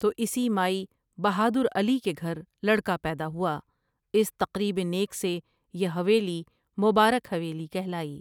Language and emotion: Urdu, neutral